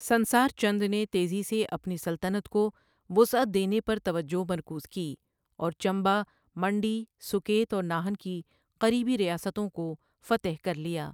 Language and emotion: Urdu, neutral